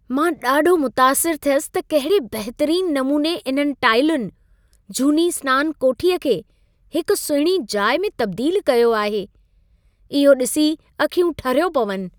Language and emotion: Sindhi, happy